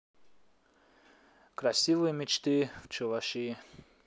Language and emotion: Russian, neutral